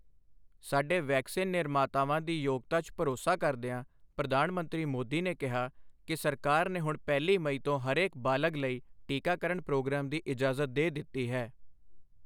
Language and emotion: Punjabi, neutral